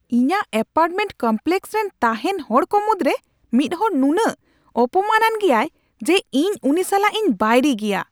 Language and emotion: Santali, angry